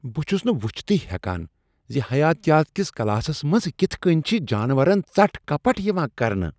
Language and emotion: Kashmiri, disgusted